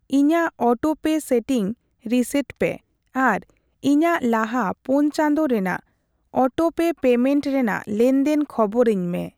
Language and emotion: Santali, neutral